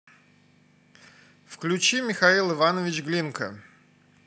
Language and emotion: Russian, neutral